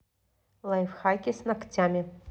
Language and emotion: Russian, neutral